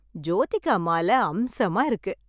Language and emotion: Tamil, happy